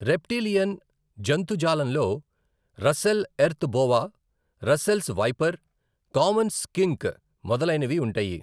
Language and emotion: Telugu, neutral